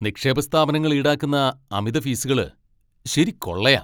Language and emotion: Malayalam, angry